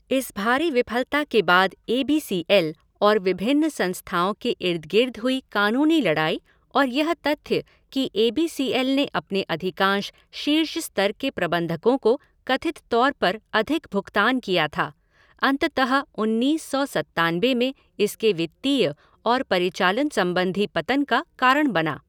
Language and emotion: Hindi, neutral